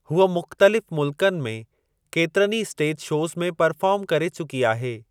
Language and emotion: Sindhi, neutral